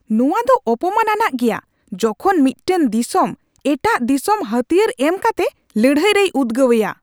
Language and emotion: Santali, angry